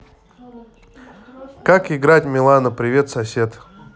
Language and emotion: Russian, neutral